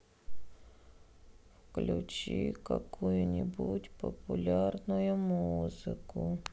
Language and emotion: Russian, sad